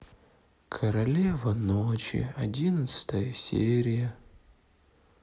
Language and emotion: Russian, sad